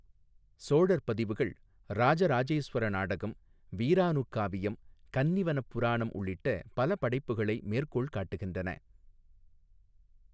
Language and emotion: Tamil, neutral